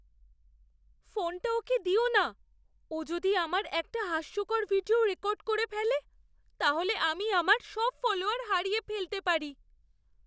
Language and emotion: Bengali, fearful